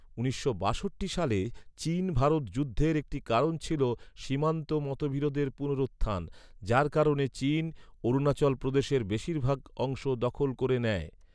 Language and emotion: Bengali, neutral